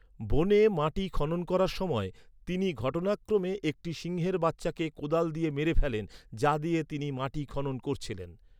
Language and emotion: Bengali, neutral